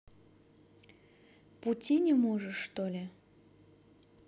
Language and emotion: Russian, neutral